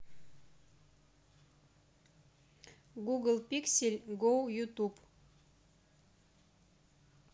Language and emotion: Russian, neutral